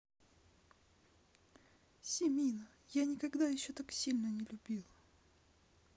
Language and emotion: Russian, sad